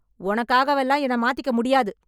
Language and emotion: Tamil, angry